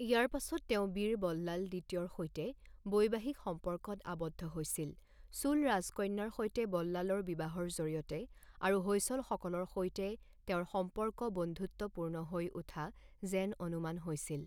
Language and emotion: Assamese, neutral